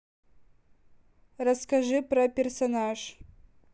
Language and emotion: Russian, neutral